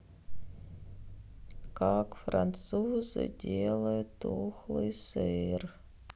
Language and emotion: Russian, sad